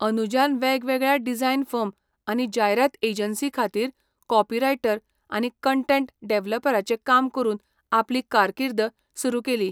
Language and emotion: Goan Konkani, neutral